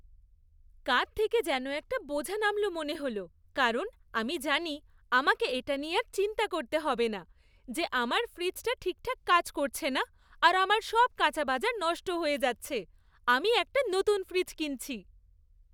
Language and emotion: Bengali, happy